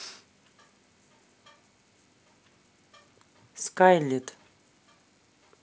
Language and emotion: Russian, neutral